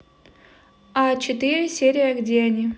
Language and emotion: Russian, neutral